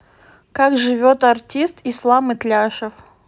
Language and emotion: Russian, neutral